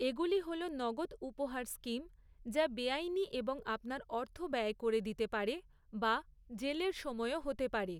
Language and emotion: Bengali, neutral